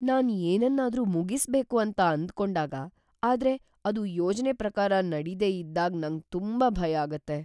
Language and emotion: Kannada, fearful